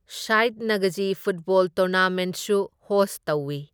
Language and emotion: Manipuri, neutral